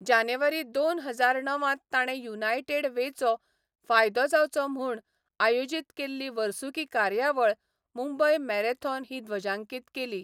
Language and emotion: Goan Konkani, neutral